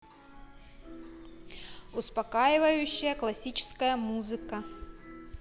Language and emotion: Russian, neutral